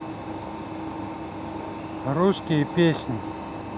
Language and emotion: Russian, neutral